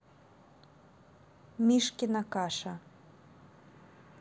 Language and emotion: Russian, neutral